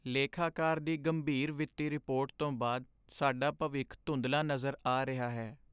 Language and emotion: Punjabi, sad